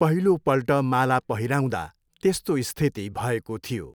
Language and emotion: Nepali, neutral